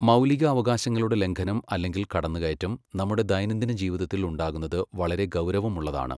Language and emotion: Malayalam, neutral